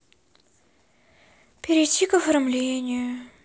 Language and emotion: Russian, sad